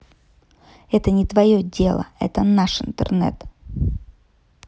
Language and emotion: Russian, angry